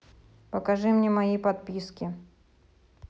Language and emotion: Russian, neutral